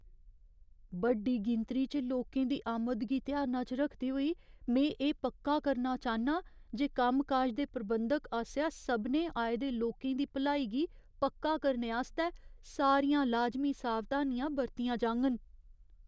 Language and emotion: Dogri, fearful